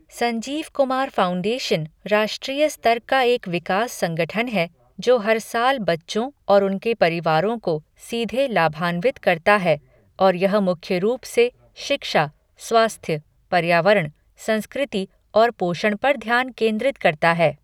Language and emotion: Hindi, neutral